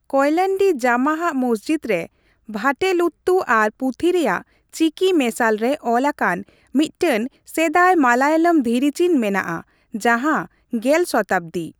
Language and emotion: Santali, neutral